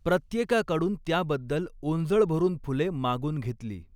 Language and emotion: Marathi, neutral